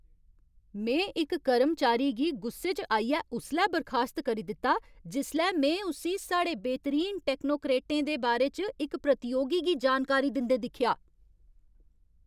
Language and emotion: Dogri, angry